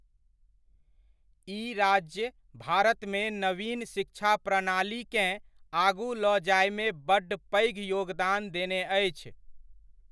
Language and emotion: Maithili, neutral